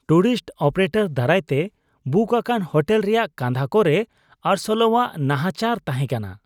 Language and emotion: Santali, disgusted